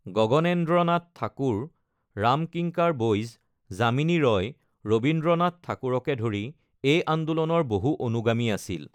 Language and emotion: Assamese, neutral